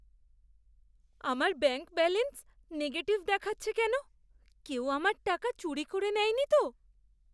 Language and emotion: Bengali, fearful